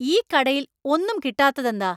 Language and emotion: Malayalam, angry